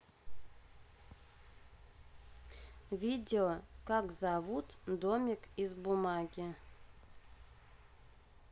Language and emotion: Russian, neutral